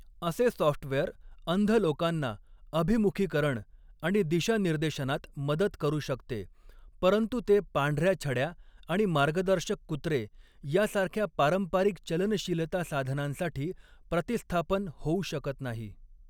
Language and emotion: Marathi, neutral